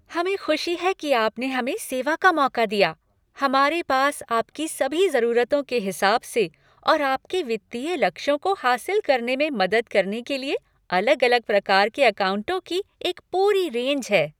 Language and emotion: Hindi, happy